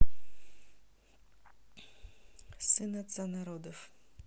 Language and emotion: Russian, neutral